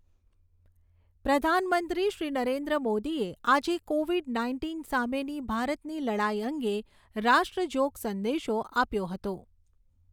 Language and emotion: Gujarati, neutral